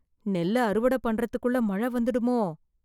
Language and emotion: Tamil, fearful